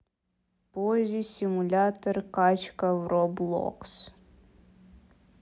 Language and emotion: Russian, neutral